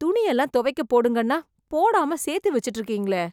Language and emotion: Tamil, disgusted